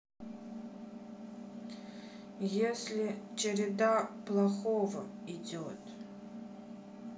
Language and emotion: Russian, sad